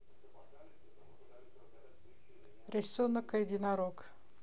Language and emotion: Russian, neutral